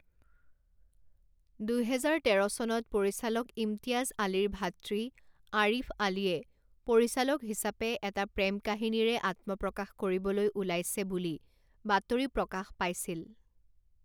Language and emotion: Assamese, neutral